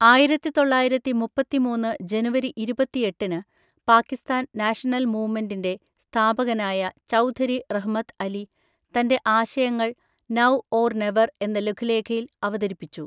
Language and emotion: Malayalam, neutral